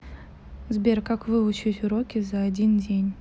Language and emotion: Russian, neutral